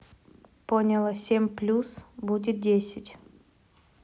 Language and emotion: Russian, neutral